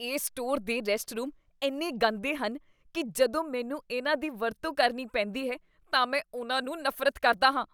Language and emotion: Punjabi, disgusted